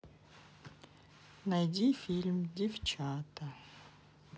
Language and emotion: Russian, neutral